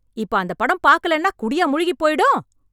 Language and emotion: Tamil, angry